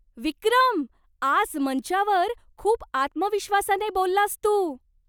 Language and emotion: Marathi, surprised